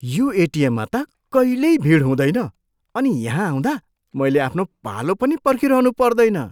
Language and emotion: Nepali, surprised